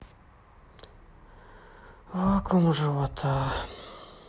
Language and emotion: Russian, sad